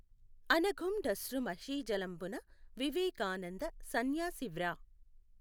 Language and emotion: Telugu, neutral